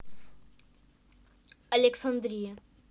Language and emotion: Russian, neutral